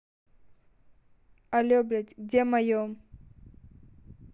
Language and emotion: Russian, angry